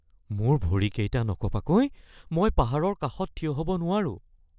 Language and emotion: Assamese, fearful